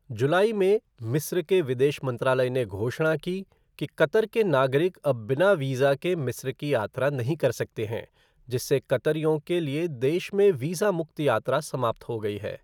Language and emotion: Hindi, neutral